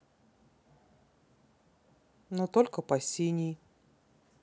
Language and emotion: Russian, neutral